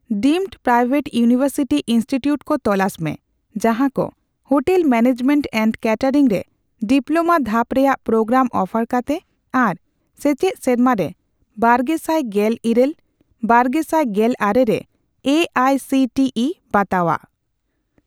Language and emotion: Santali, neutral